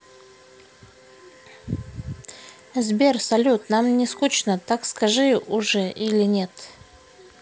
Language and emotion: Russian, neutral